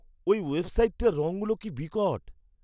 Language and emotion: Bengali, disgusted